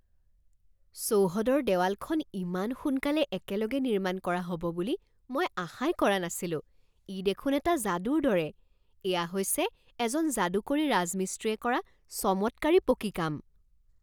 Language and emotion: Assamese, surprised